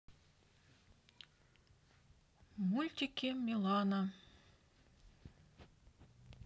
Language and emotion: Russian, neutral